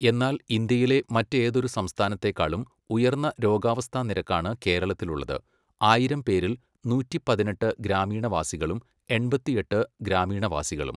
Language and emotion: Malayalam, neutral